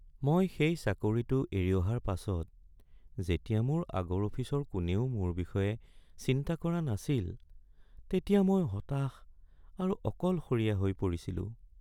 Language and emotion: Assamese, sad